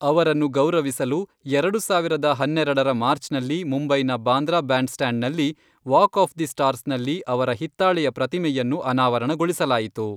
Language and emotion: Kannada, neutral